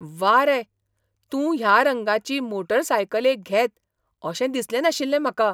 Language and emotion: Goan Konkani, surprised